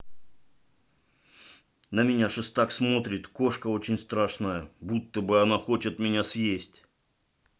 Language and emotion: Russian, neutral